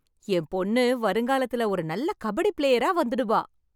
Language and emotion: Tamil, happy